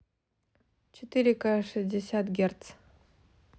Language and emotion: Russian, neutral